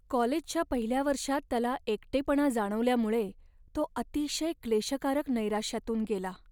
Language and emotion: Marathi, sad